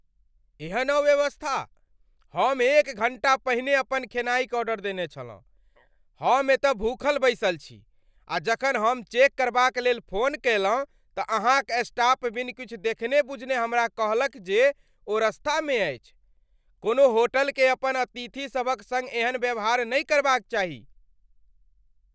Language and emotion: Maithili, angry